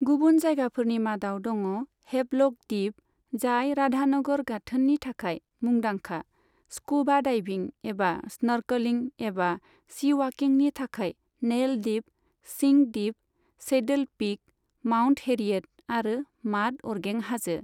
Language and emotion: Bodo, neutral